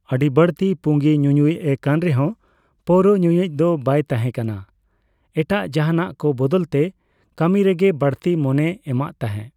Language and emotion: Santali, neutral